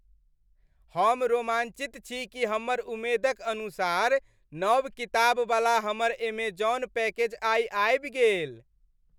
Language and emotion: Maithili, happy